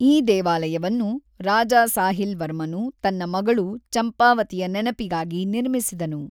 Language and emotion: Kannada, neutral